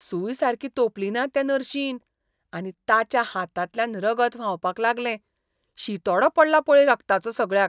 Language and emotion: Goan Konkani, disgusted